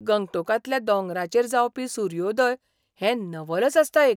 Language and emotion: Goan Konkani, surprised